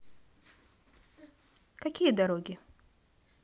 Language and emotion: Russian, positive